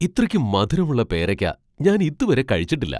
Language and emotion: Malayalam, surprised